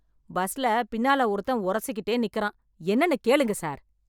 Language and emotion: Tamil, angry